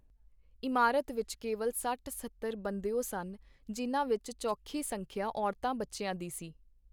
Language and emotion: Punjabi, neutral